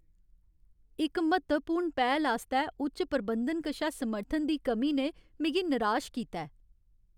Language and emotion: Dogri, sad